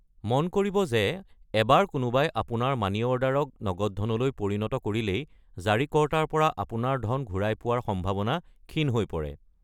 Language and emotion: Assamese, neutral